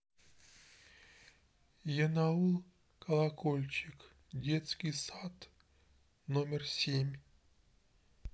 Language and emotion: Russian, sad